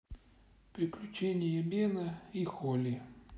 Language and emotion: Russian, neutral